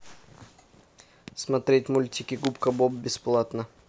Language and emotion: Russian, neutral